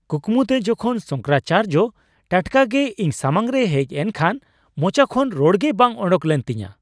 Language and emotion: Santali, surprised